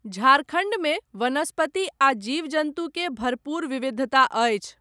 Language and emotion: Maithili, neutral